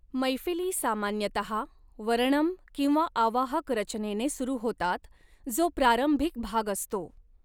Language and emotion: Marathi, neutral